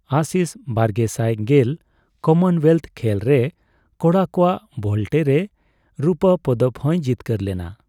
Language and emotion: Santali, neutral